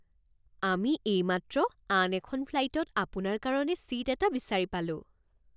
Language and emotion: Assamese, surprised